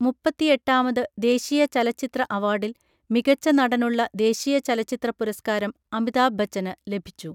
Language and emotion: Malayalam, neutral